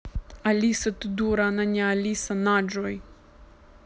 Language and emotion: Russian, angry